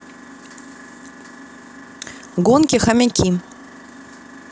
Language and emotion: Russian, neutral